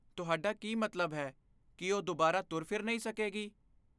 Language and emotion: Punjabi, fearful